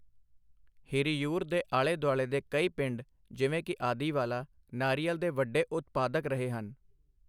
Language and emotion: Punjabi, neutral